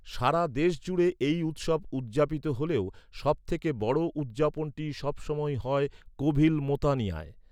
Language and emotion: Bengali, neutral